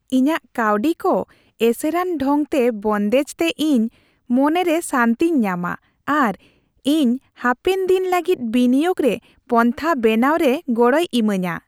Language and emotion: Santali, happy